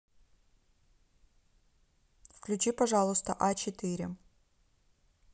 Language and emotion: Russian, neutral